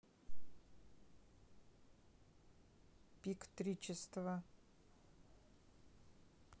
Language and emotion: Russian, neutral